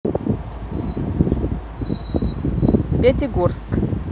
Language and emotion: Russian, neutral